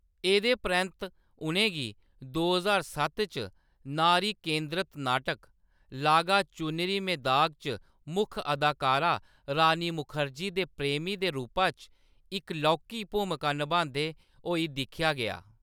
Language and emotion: Dogri, neutral